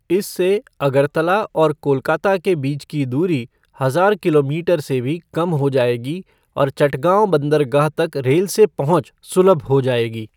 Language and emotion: Hindi, neutral